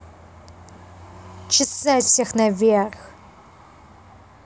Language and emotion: Russian, angry